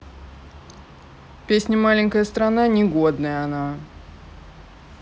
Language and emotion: Russian, neutral